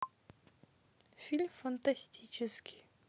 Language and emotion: Russian, neutral